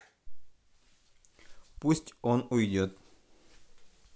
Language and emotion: Russian, neutral